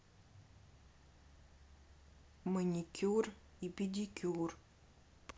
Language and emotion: Russian, neutral